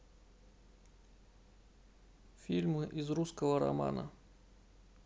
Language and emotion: Russian, neutral